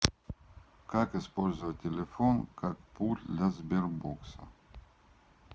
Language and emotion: Russian, neutral